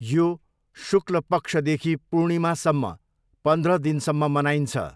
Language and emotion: Nepali, neutral